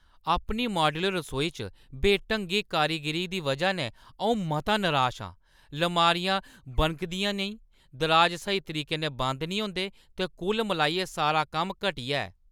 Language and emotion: Dogri, angry